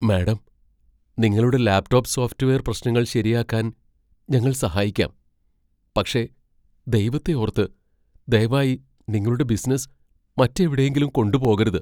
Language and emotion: Malayalam, fearful